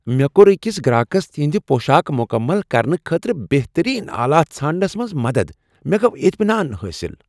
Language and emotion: Kashmiri, happy